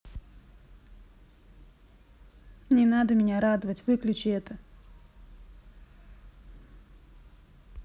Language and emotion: Russian, sad